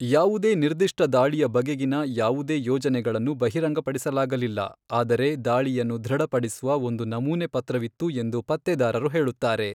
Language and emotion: Kannada, neutral